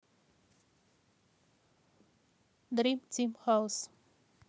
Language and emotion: Russian, neutral